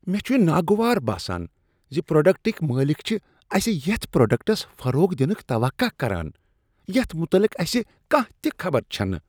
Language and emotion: Kashmiri, disgusted